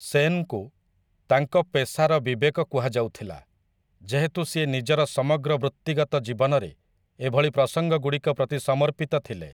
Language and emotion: Odia, neutral